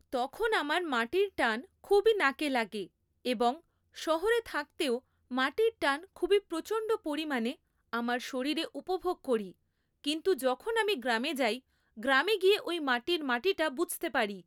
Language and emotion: Bengali, neutral